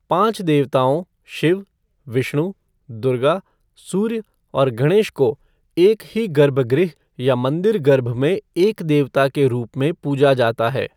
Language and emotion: Hindi, neutral